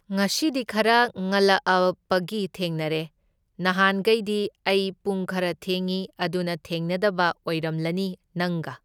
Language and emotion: Manipuri, neutral